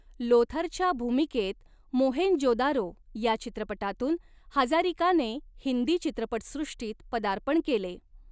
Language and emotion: Marathi, neutral